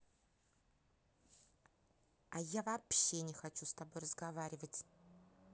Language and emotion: Russian, angry